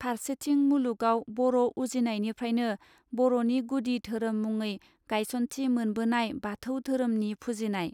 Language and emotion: Bodo, neutral